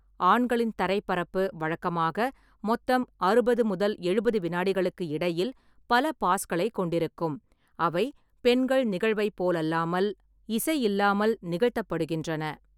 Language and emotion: Tamil, neutral